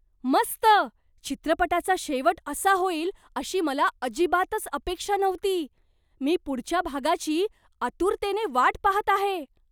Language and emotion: Marathi, surprised